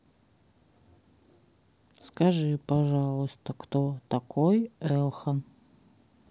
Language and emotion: Russian, neutral